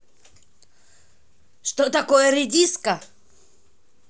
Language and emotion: Russian, angry